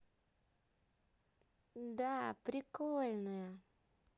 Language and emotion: Russian, positive